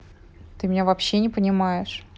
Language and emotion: Russian, angry